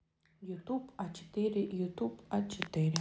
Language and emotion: Russian, neutral